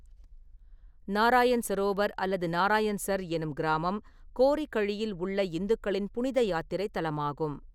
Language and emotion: Tamil, neutral